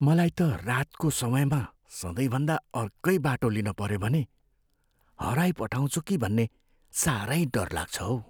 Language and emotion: Nepali, fearful